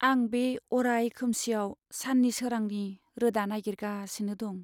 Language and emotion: Bodo, sad